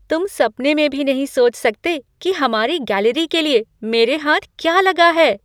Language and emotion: Hindi, surprised